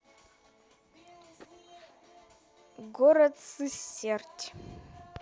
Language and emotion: Russian, neutral